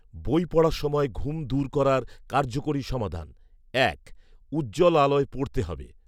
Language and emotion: Bengali, neutral